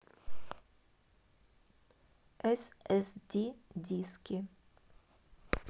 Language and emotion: Russian, neutral